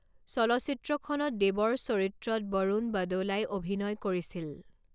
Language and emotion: Assamese, neutral